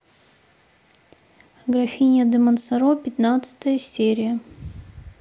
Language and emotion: Russian, neutral